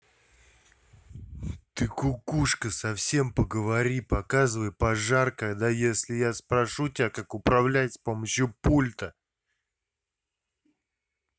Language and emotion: Russian, angry